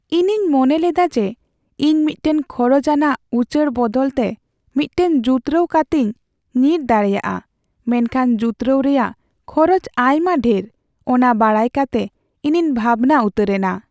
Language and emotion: Santali, sad